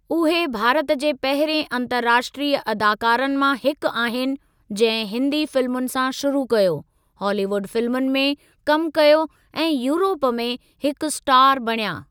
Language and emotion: Sindhi, neutral